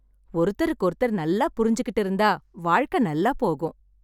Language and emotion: Tamil, happy